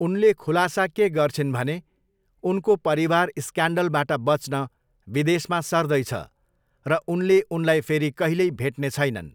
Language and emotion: Nepali, neutral